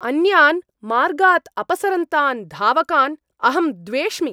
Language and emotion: Sanskrit, angry